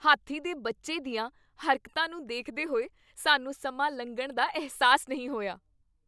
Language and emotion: Punjabi, happy